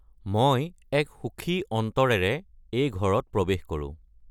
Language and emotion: Assamese, neutral